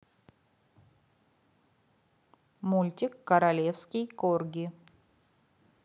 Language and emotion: Russian, neutral